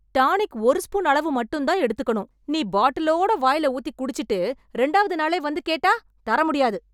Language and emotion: Tamil, angry